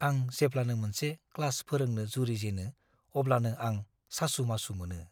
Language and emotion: Bodo, fearful